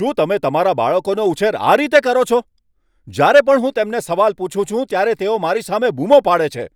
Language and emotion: Gujarati, angry